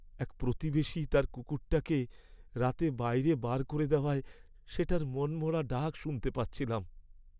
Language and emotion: Bengali, sad